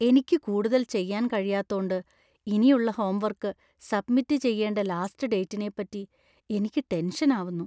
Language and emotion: Malayalam, fearful